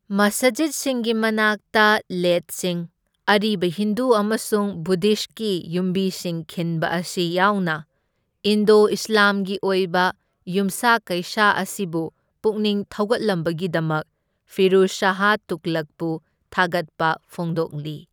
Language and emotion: Manipuri, neutral